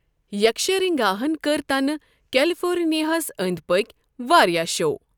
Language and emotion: Kashmiri, neutral